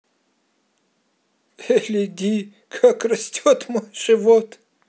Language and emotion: Russian, positive